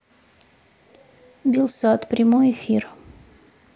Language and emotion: Russian, neutral